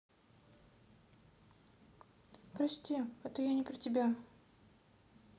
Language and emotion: Russian, sad